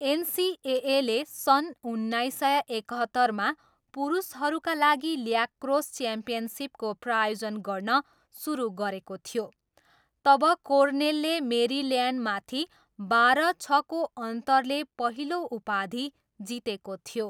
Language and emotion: Nepali, neutral